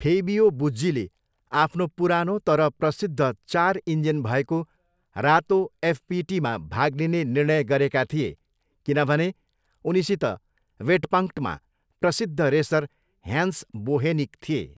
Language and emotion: Nepali, neutral